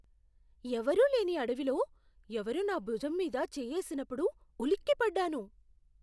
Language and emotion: Telugu, surprised